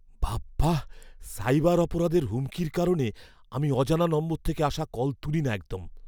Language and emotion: Bengali, fearful